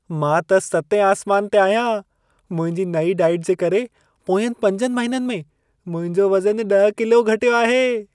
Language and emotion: Sindhi, happy